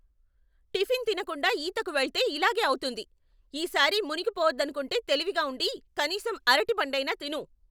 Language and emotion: Telugu, angry